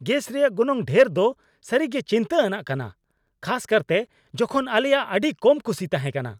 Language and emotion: Santali, angry